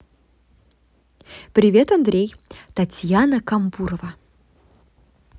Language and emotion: Russian, positive